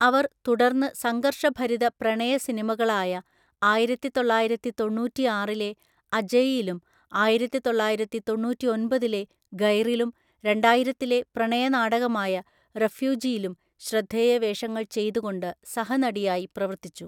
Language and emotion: Malayalam, neutral